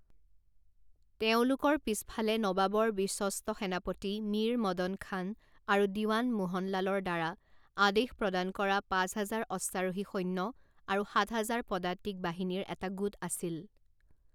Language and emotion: Assamese, neutral